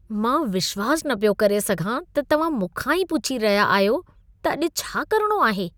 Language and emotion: Sindhi, disgusted